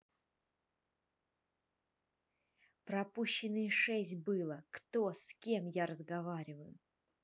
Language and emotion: Russian, angry